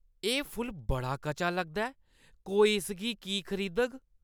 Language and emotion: Dogri, disgusted